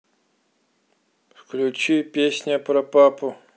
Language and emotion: Russian, neutral